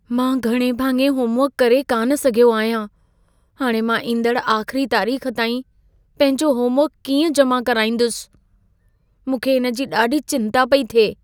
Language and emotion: Sindhi, fearful